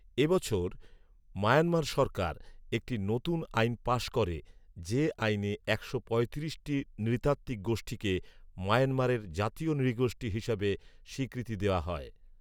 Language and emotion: Bengali, neutral